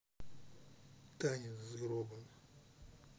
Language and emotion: Russian, neutral